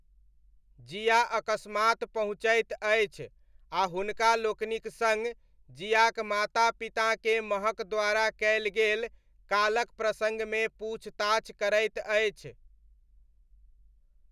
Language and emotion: Maithili, neutral